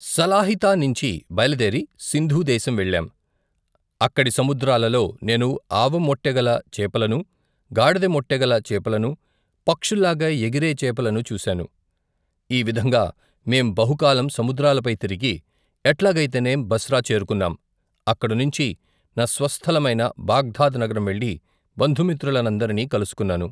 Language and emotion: Telugu, neutral